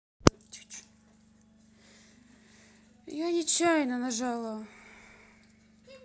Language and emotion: Russian, sad